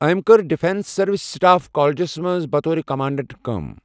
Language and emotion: Kashmiri, neutral